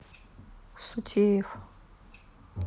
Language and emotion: Russian, neutral